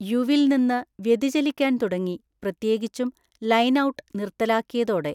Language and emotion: Malayalam, neutral